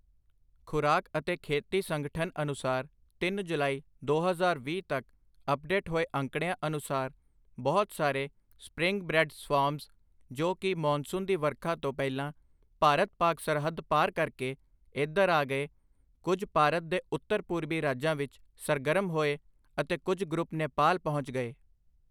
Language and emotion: Punjabi, neutral